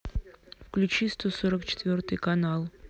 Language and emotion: Russian, neutral